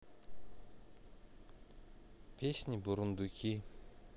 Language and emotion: Russian, neutral